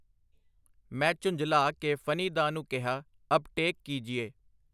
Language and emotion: Punjabi, neutral